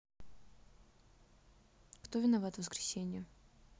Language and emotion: Russian, neutral